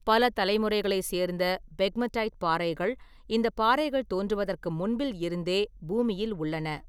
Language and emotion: Tamil, neutral